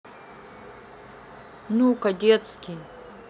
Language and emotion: Russian, neutral